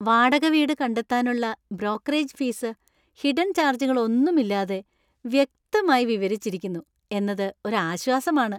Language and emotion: Malayalam, happy